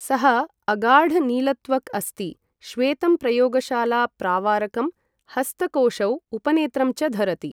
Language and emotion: Sanskrit, neutral